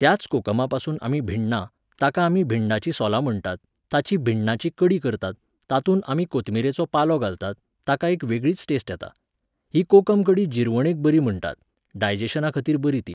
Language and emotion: Goan Konkani, neutral